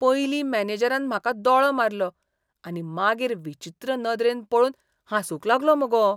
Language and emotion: Goan Konkani, disgusted